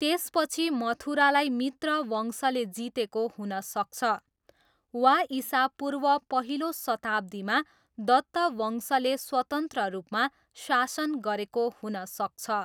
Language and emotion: Nepali, neutral